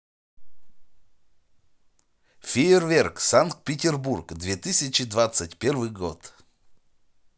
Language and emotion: Russian, positive